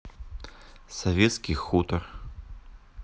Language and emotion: Russian, neutral